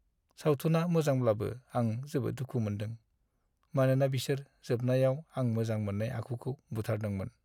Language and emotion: Bodo, sad